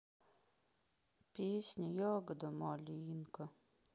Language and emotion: Russian, sad